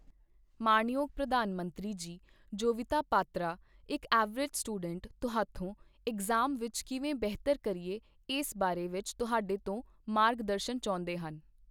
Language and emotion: Punjabi, neutral